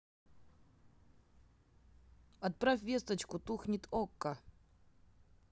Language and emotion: Russian, neutral